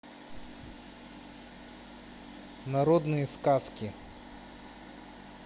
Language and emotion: Russian, neutral